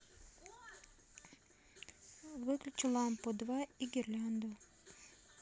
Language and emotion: Russian, neutral